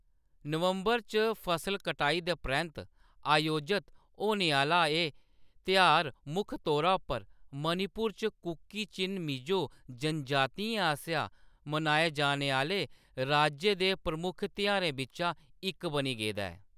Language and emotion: Dogri, neutral